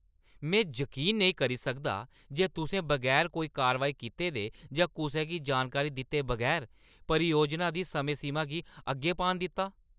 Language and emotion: Dogri, angry